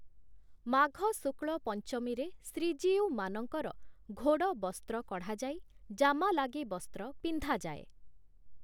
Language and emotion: Odia, neutral